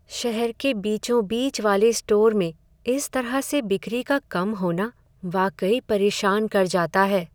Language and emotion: Hindi, sad